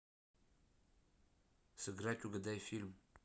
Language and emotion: Russian, neutral